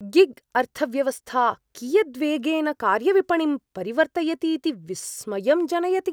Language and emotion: Sanskrit, surprised